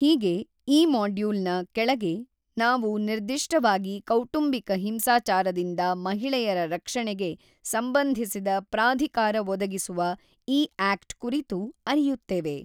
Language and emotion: Kannada, neutral